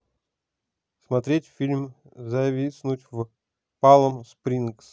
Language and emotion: Russian, neutral